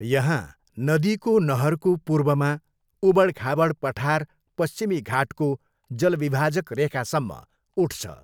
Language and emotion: Nepali, neutral